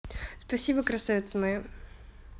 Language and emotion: Russian, positive